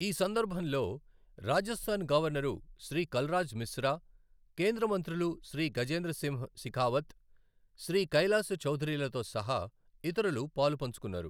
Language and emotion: Telugu, neutral